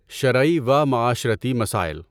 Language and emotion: Urdu, neutral